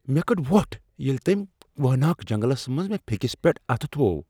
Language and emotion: Kashmiri, surprised